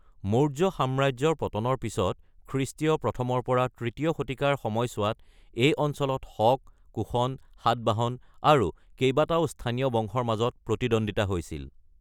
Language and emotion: Assamese, neutral